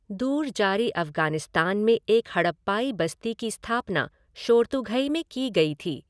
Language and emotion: Hindi, neutral